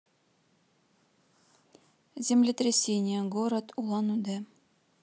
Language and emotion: Russian, neutral